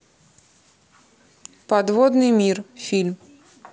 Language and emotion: Russian, neutral